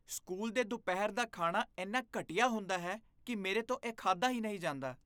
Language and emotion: Punjabi, disgusted